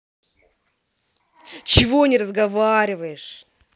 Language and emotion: Russian, angry